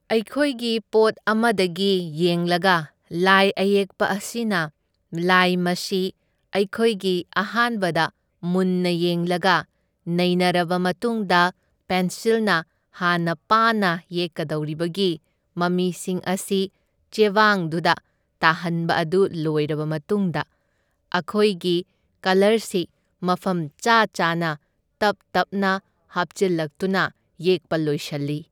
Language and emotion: Manipuri, neutral